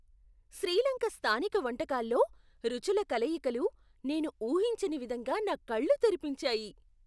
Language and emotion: Telugu, surprised